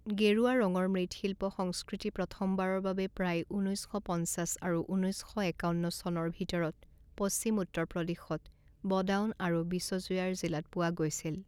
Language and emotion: Assamese, neutral